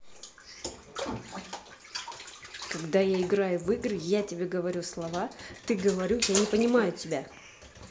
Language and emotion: Russian, angry